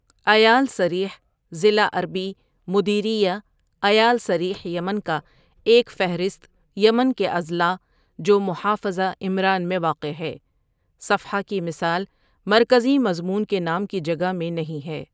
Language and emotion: Urdu, neutral